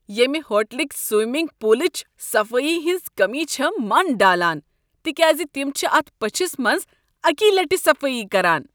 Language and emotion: Kashmiri, disgusted